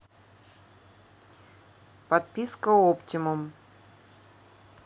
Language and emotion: Russian, neutral